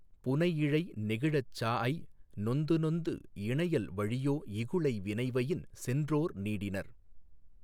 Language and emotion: Tamil, neutral